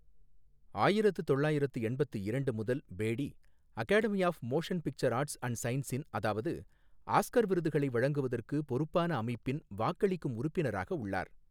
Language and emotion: Tamil, neutral